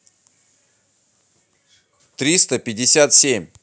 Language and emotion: Russian, neutral